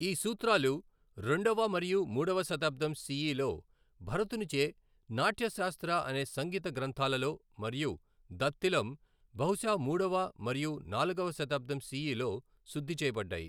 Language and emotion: Telugu, neutral